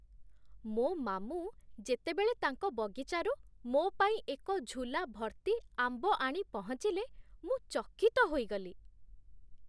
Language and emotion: Odia, surprised